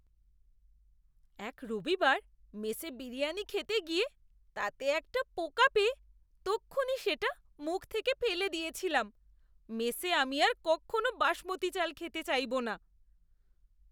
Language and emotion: Bengali, disgusted